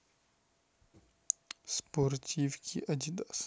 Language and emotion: Russian, neutral